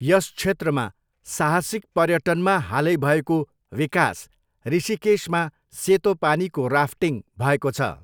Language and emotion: Nepali, neutral